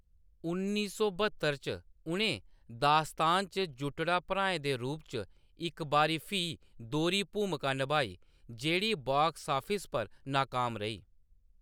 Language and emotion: Dogri, neutral